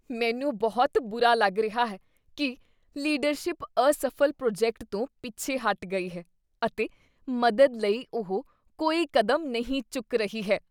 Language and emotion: Punjabi, disgusted